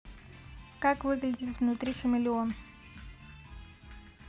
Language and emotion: Russian, neutral